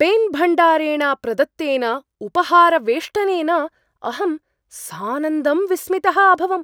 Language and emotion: Sanskrit, surprised